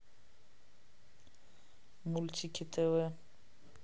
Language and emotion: Russian, neutral